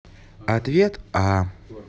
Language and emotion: Russian, neutral